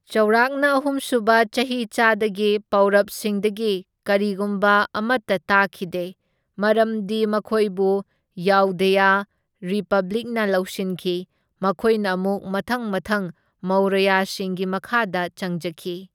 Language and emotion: Manipuri, neutral